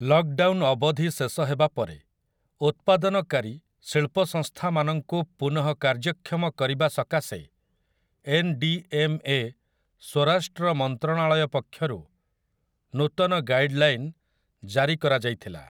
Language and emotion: Odia, neutral